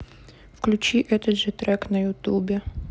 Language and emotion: Russian, neutral